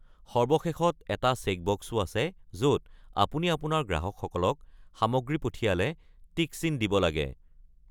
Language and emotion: Assamese, neutral